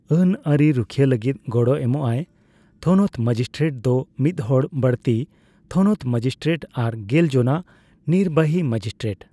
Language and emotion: Santali, neutral